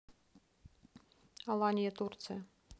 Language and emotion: Russian, neutral